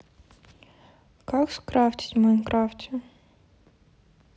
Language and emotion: Russian, neutral